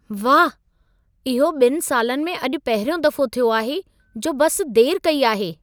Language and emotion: Sindhi, surprised